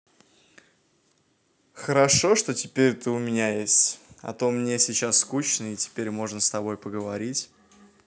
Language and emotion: Russian, positive